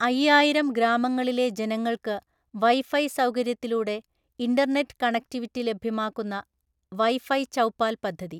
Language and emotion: Malayalam, neutral